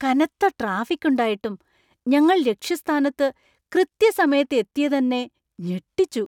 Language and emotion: Malayalam, surprised